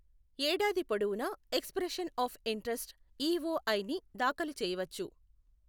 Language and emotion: Telugu, neutral